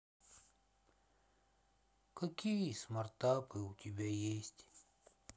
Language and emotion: Russian, sad